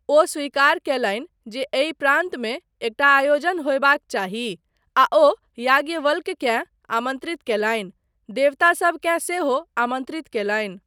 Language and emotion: Maithili, neutral